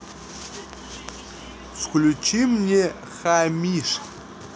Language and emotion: Russian, neutral